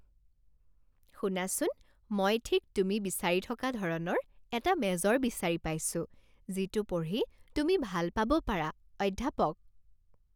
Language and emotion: Assamese, happy